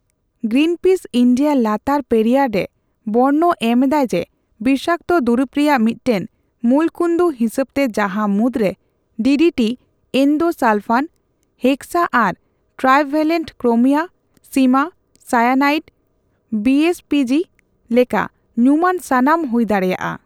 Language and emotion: Santali, neutral